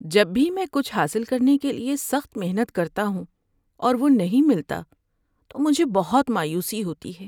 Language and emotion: Urdu, sad